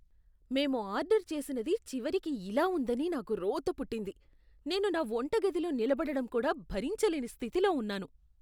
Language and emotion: Telugu, disgusted